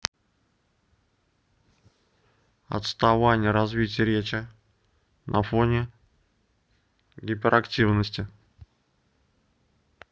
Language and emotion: Russian, neutral